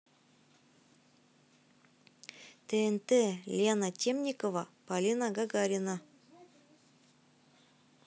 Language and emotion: Russian, neutral